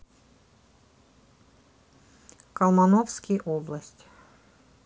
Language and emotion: Russian, neutral